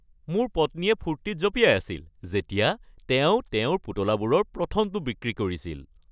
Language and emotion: Assamese, happy